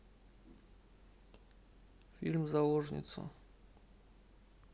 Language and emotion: Russian, neutral